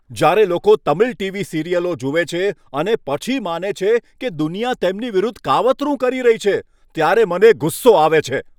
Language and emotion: Gujarati, angry